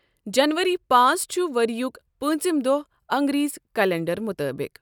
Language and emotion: Kashmiri, neutral